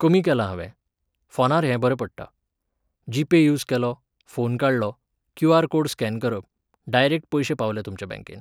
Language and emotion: Goan Konkani, neutral